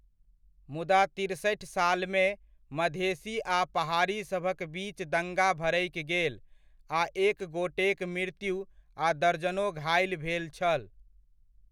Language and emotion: Maithili, neutral